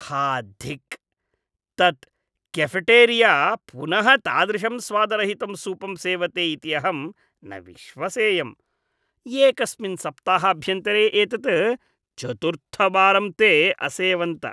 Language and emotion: Sanskrit, disgusted